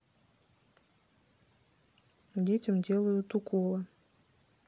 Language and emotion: Russian, neutral